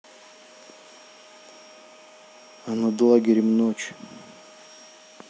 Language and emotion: Russian, neutral